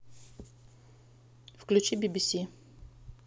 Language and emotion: Russian, neutral